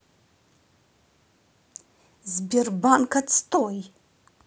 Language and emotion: Russian, angry